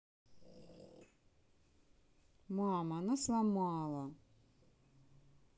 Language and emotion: Russian, sad